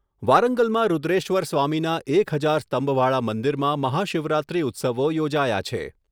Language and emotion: Gujarati, neutral